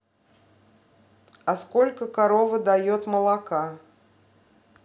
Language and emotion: Russian, neutral